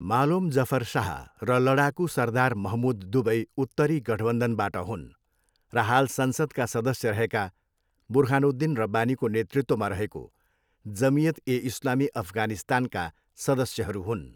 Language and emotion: Nepali, neutral